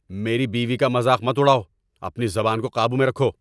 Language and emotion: Urdu, angry